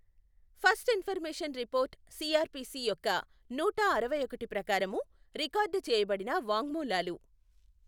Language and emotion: Telugu, neutral